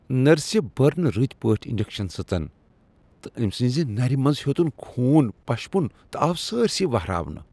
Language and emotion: Kashmiri, disgusted